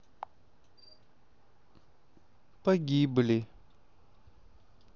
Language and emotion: Russian, sad